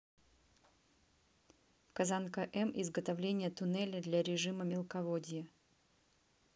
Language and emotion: Russian, neutral